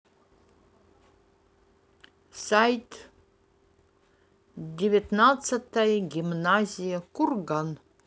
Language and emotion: Russian, neutral